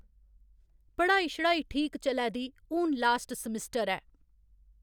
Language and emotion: Dogri, neutral